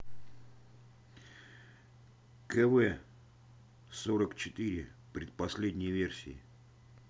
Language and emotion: Russian, neutral